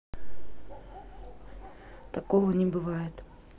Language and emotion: Russian, neutral